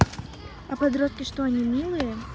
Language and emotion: Russian, neutral